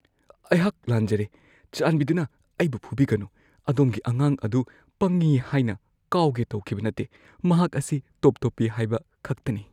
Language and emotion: Manipuri, fearful